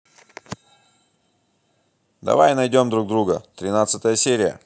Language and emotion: Russian, positive